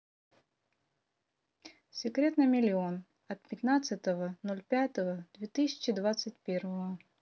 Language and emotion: Russian, neutral